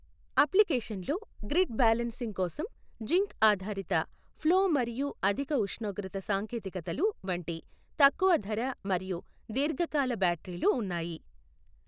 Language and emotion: Telugu, neutral